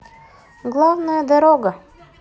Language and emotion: Russian, neutral